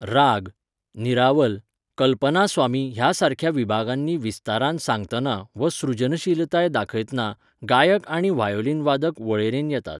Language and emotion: Goan Konkani, neutral